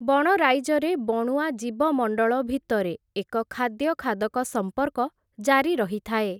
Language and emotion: Odia, neutral